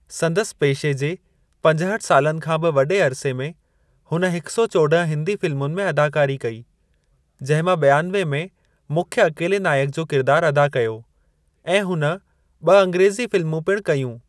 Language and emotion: Sindhi, neutral